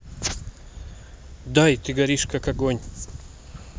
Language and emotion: Russian, neutral